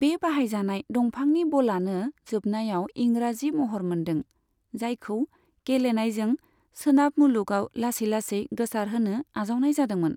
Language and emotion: Bodo, neutral